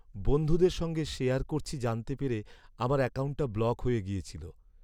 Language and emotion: Bengali, sad